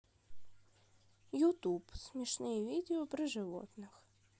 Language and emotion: Russian, neutral